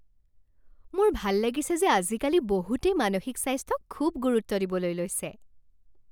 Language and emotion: Assamese, happy